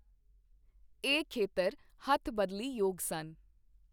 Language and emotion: Punjabi, neutral